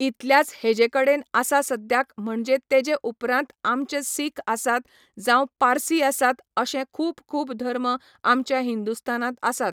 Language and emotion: Goan Konkani, neutral